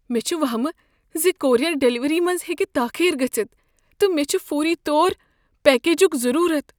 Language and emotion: Kashmiri, fearful